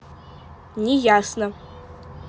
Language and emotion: Russian, neutral